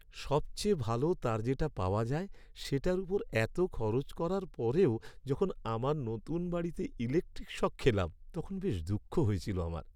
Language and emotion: Bengali, sad